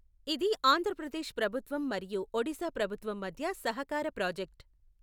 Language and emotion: Telugu, neutral